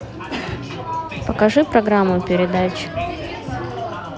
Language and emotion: Russian, neutral